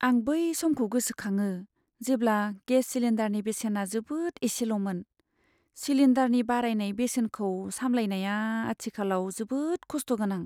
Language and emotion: Bodo, sad